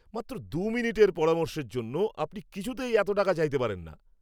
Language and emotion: Bengali, angry